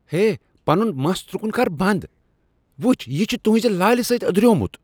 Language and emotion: Kashmiri, disgusted